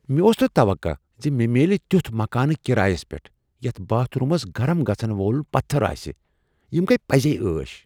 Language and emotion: Kashmiri, surprised